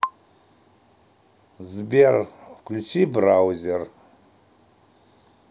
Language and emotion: Russian, neutral